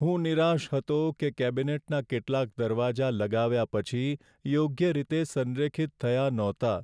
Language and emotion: Gujarati, sad